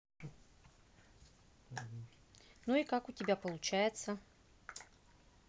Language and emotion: Russian, neutral